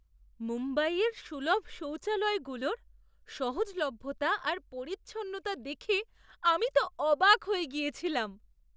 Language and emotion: Bengali, surprised